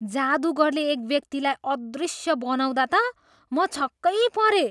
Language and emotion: Nepali, surprised